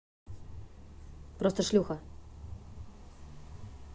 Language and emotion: Russian, neutral